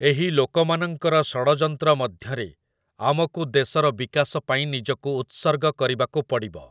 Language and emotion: Odia, neutral